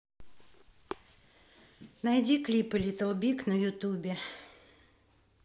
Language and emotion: Russian, neutral